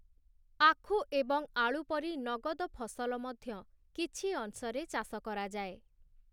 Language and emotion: Odia, neutral